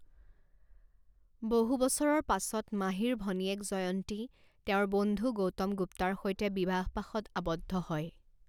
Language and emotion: Assamese, neutral